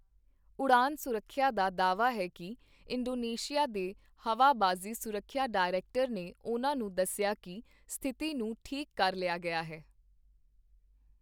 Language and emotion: Punjabi, neutral